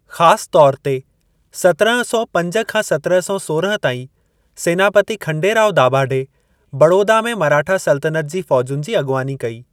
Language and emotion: Sindhi, neutral